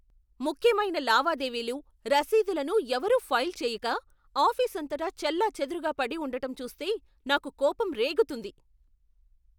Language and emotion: Telugu, angry